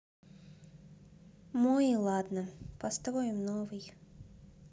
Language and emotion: Russian, sad